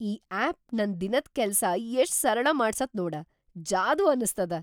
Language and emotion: Kannada, surprised